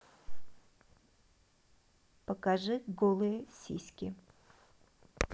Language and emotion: Russian, neutral